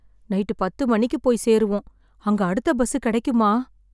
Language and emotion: Tamil, sad